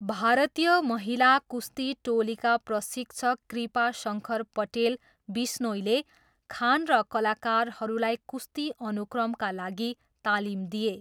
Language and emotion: Nepali, neutral